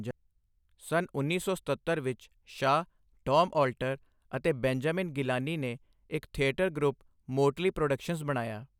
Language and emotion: Punjabi, neutral